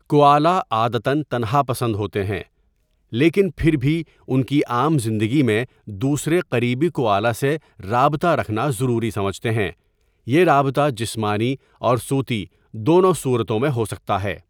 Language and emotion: Urdu, neutral